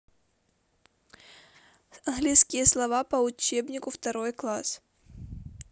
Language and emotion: Russian, neutral